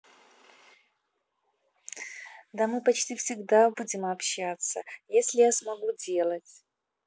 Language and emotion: Russian, positive